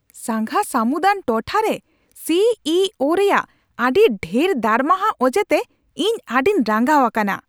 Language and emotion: Santali, angry